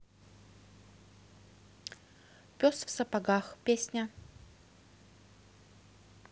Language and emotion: Russian, neutral